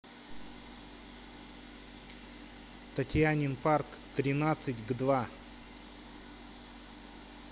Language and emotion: Russian, neutral